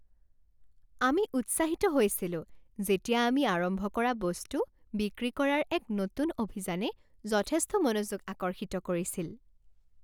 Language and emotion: Assamese, happy